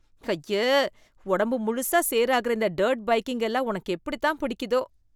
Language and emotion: Tamil, disgusted